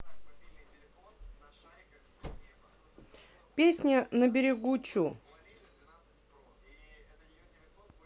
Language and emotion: Russian, neutral